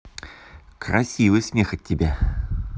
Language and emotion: Russian, positive